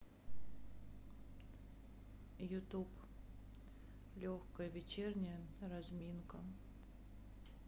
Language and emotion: Russian, sad